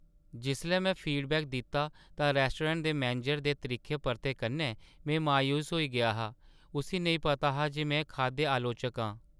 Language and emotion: Dogri, sad